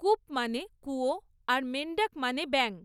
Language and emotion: Bengali, neutral